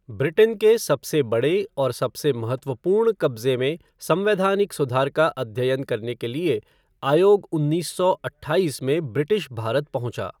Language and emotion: Hindi, neutral